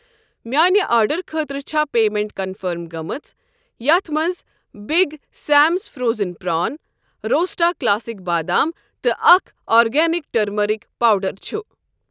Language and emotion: Kashmiri, neutral